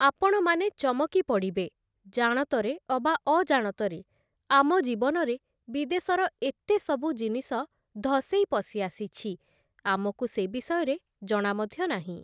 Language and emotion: Odia, neutral